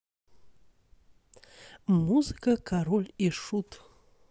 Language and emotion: Russian, positive